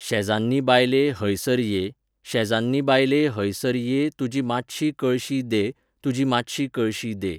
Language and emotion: Goan Konkani, neutral